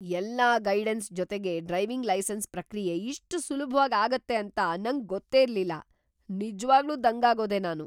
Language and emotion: Kannada, surprised